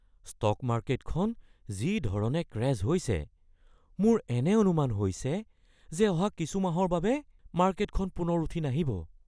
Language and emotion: Assamese, fearful